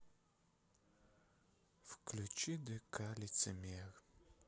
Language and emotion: Russian, sad